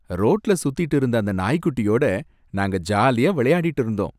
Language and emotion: Tamil, happy